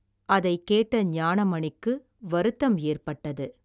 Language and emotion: Tamil, neutral